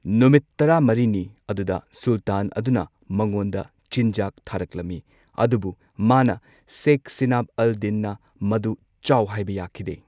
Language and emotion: Manipuri, neutral